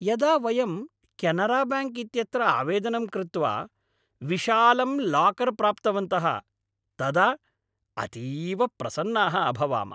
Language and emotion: Sanskrit, happy